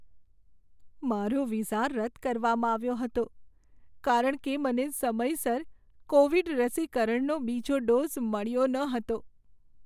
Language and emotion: Gujarati, sad